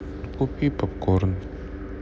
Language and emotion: Russian, sad